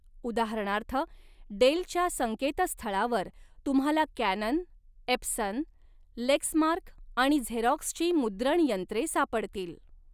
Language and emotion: Marathi, neutral